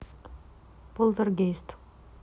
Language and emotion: Russian, neutral